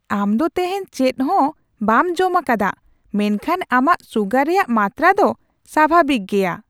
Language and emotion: Santali, surprised